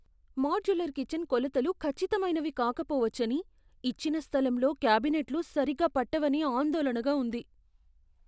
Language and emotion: Telugu, fearful